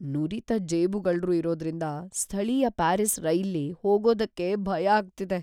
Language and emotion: Kannada, fearful